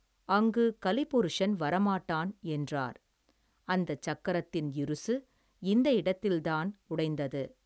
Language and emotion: Tamil, neutral